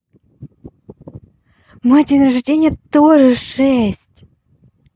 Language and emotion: Russian, positive